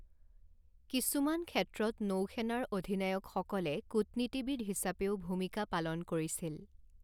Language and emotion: Assamese, neutral